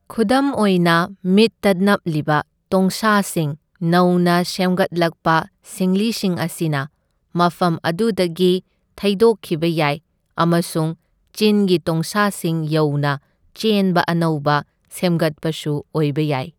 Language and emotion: Manipuri, neutral